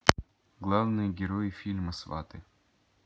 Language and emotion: Russian, neutral